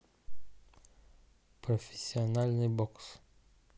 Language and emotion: Russian, neutral